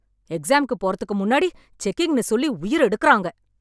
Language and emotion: Tamil, angry